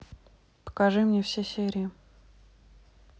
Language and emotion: Russian, neutral